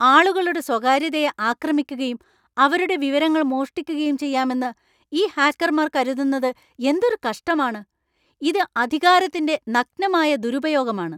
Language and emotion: Malayalam, angry